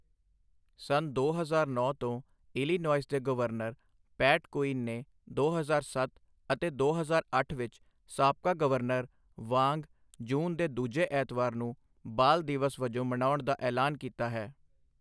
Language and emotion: Punjabi, neutral